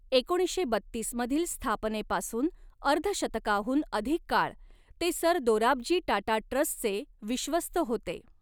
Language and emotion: Marathi, neutral